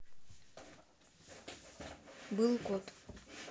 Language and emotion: Russian, neutral